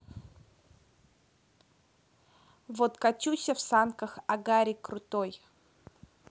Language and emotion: Russian, neutral